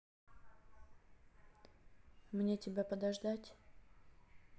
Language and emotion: Russian, sad